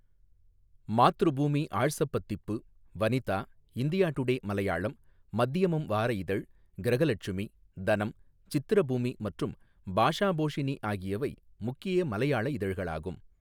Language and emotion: Tamil, neutral